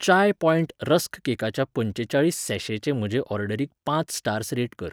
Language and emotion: Goan Konkani, neutral